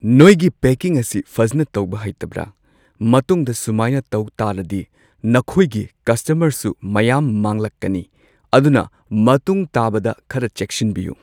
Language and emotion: Manipuri, neutral